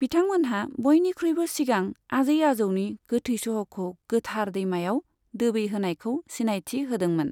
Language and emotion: Bodo, neutral